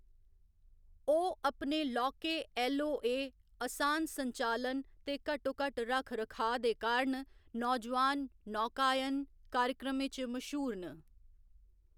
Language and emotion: Dogri, neutral